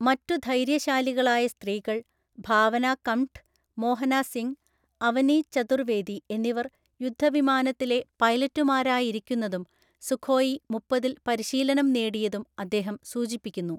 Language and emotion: Malayalam, neutral